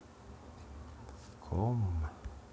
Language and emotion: Russian, sad